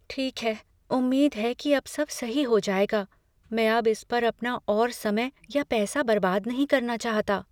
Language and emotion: Hindi, fearful